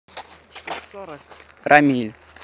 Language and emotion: Russian, neutral